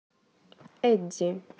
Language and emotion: Russian, neutral